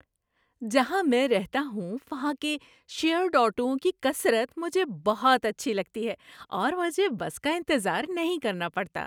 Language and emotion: Urdu, happy